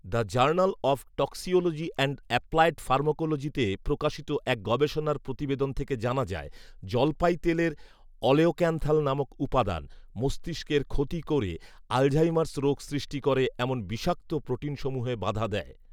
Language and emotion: Bengali, neutral